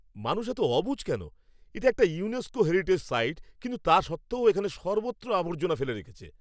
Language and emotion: Bengali, angry